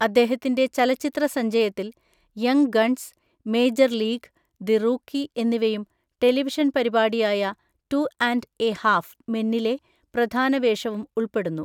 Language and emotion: Malayalam, neutral